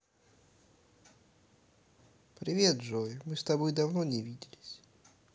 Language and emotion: Russian, neutral